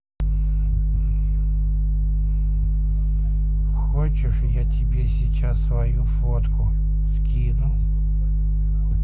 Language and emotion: Russian, neutral